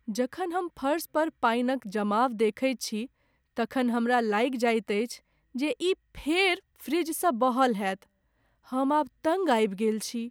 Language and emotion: Maithili, sad